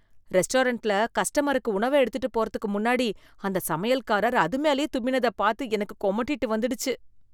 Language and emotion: Tamil, disgusted